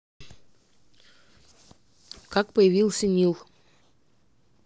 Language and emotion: Russian, neutral